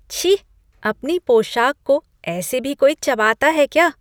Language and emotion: Hindi, disgusted